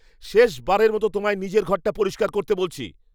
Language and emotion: Bengali, angry